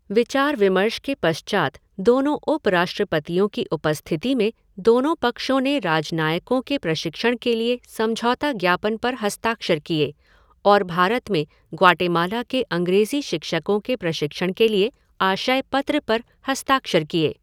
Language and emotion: Hindi, neutral